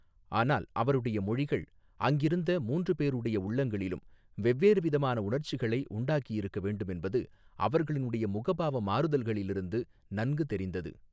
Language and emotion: Tamil, neutral